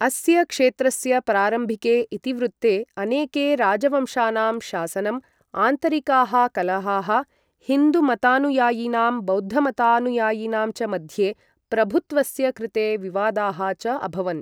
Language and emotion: Sanskrit, neutral